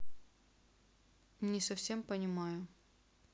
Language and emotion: Russian, neutral